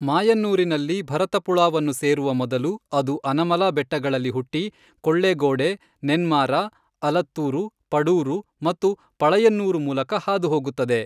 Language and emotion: Kannada, neutral